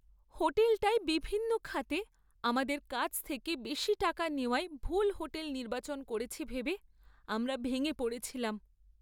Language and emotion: Bengali, sad